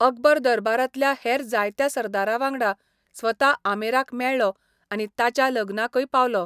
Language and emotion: Goan Konkani, neutral